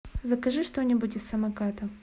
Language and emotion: Russian, neutral